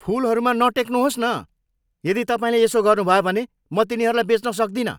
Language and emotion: Nepali, angry